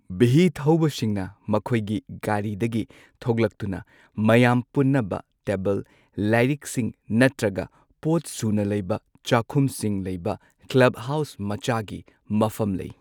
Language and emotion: Manipuri, neutral